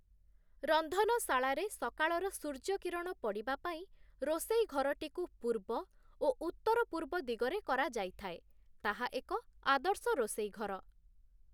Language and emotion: Odia, neutral